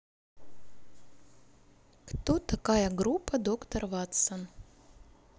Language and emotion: Russian, neutral